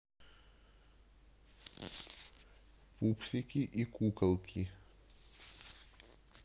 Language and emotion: Russian, neutral